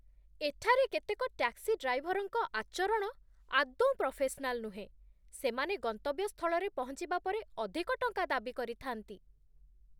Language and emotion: Odia, disgusted